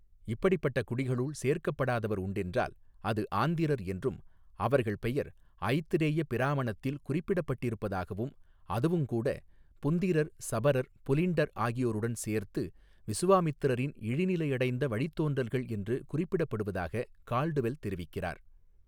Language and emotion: Tamil, neutral